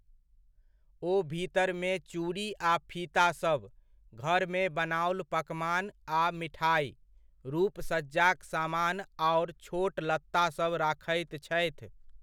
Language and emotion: Maithili, neutral